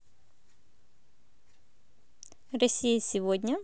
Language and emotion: Russian, positive